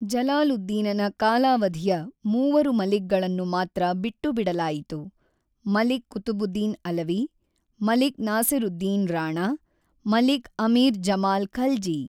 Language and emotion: Kannada, neutral